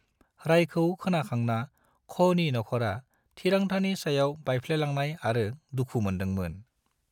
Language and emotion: Bodo, neutral